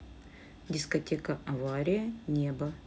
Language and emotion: Russian, neutral